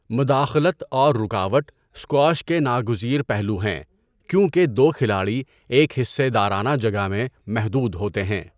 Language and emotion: Urdu, neutral